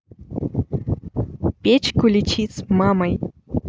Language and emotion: Russian, neutral